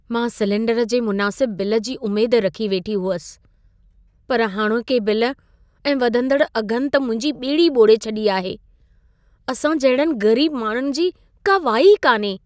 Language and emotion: Sindhi, sad